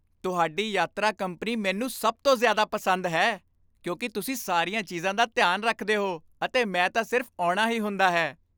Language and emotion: Punjabi, happy